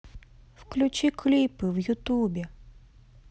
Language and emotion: Russian, sad